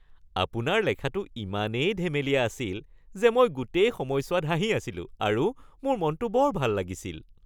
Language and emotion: Assamese, happy